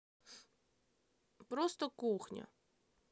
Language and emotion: Russian, sad